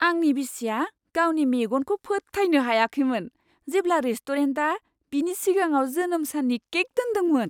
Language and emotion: Bodo, surprised